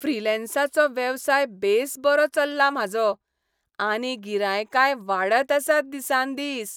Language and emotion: Goan Konkani, happy